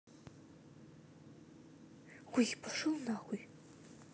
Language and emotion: Russian, angry